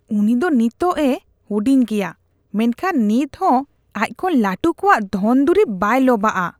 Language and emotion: Santali, disgusted